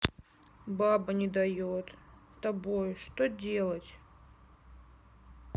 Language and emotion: Russian, sad